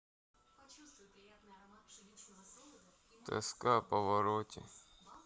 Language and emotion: Russian, sad